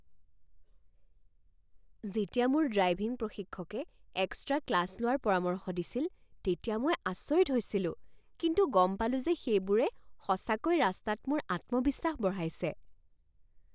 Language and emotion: Assamese, surprised